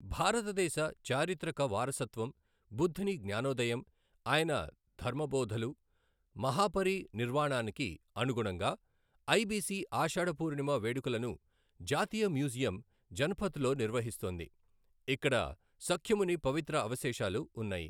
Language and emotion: Telugu, neutral